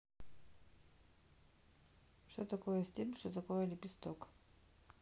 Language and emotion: Russian, neutral